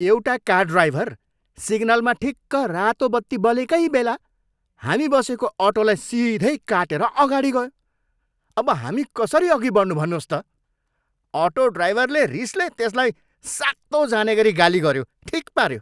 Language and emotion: Nepali, angry